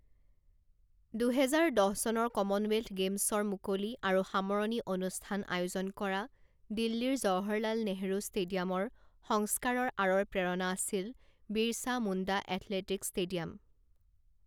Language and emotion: Assamese, neutral